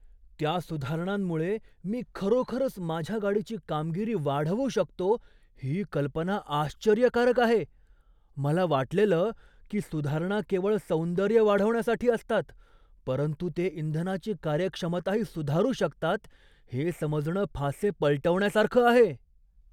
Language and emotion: Marathi, surprised